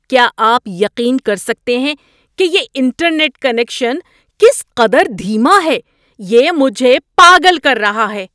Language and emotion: Urdu, angry